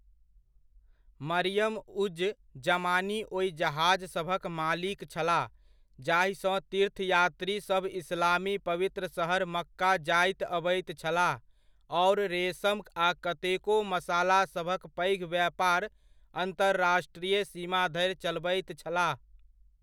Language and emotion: Maithili, neutral